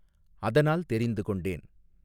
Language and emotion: Tamil, neutral